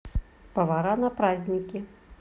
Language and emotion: Russian, positive